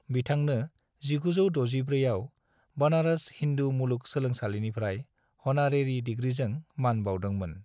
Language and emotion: Bodo, neutral